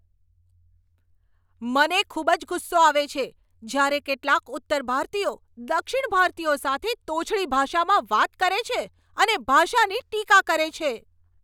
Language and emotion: Gujarati, angry